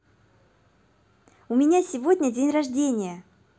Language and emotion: Russian, positive